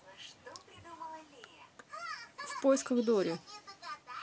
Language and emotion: Russian, neutral